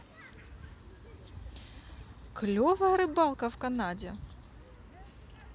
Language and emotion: Russian, positive